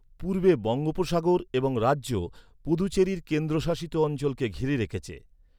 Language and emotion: Bengali, neutral